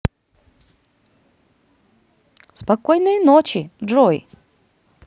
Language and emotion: Russian, positive